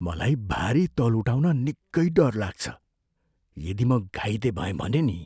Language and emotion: Nepali, fearful